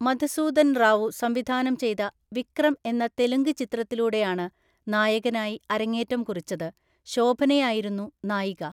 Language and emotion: Malayalam, neutral